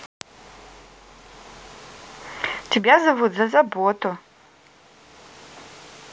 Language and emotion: Russian, positive